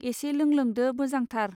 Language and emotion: Bodo, neutral